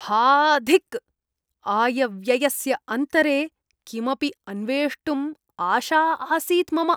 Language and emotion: Sanskrit, disgusted